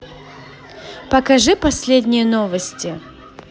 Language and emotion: Russian, positive